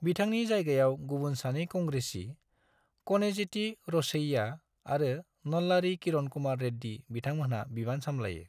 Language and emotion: Bodo, neutral